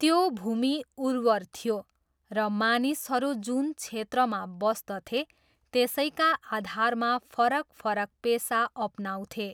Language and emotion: Nepali, neutral